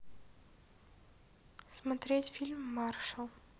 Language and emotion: Russian, neutral